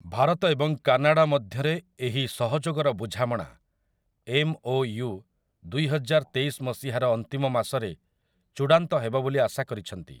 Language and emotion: Odia, neutral